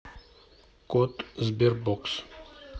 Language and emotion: Russian, neutral